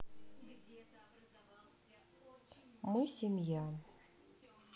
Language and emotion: Russian, neutral